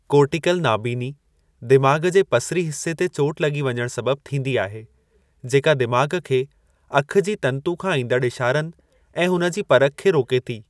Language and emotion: Sindhi, neutral